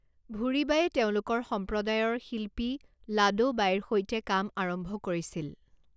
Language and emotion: Assamese, neutral